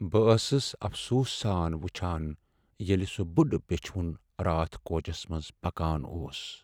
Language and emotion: Kashmiri, sad